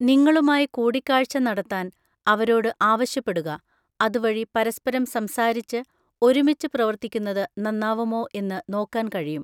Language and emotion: Malayalam, neutral